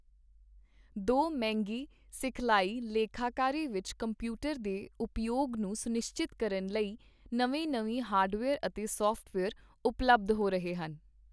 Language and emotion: Punjabi, neutral